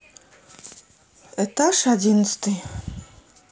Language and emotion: Russian, neutral